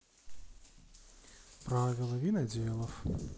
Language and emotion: Russian, neutral